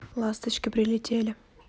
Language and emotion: Russian, neutral